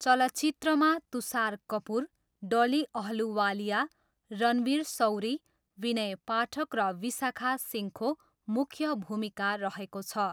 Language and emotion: Nepali, neutral